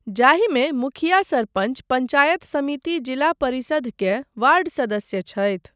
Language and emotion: Maithili, neutral